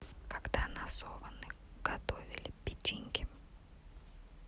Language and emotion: Russian, neutral